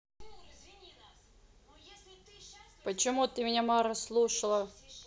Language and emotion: Russian, neutral